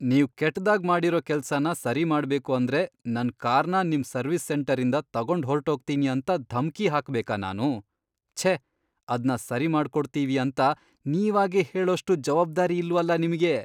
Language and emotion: Kannada, disgusted